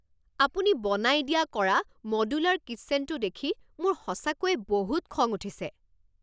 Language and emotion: Assamese, angry